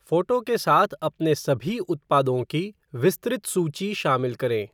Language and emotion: Hindi, neutral